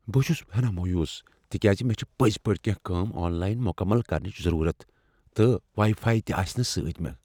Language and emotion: Kashmiri, fearful